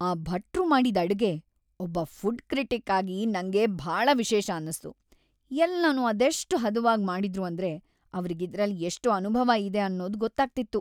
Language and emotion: Kannada, happy